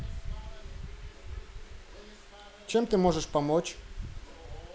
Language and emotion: Russian, neutral